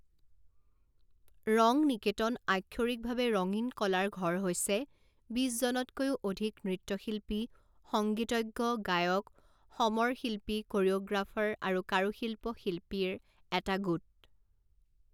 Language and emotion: Assamese, neutral